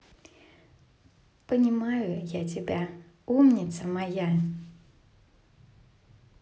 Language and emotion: Russian, positive